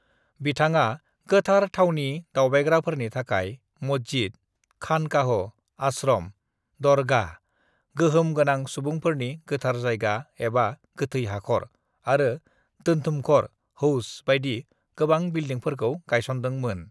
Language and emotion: Bodo, neutral